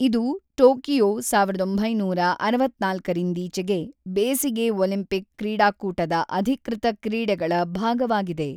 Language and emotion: Kannada, neutral